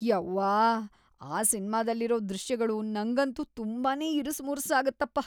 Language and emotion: Kannada, disgusted